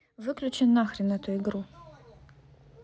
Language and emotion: Russian, angry